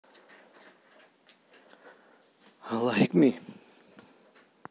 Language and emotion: Russian, neutral